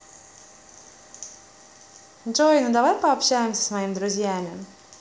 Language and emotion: Russian, positive